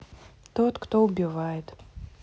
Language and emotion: Russian, neutral